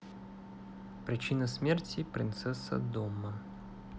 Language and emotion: Russian, neutral